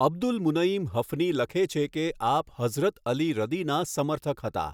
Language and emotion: Gujarati, neutral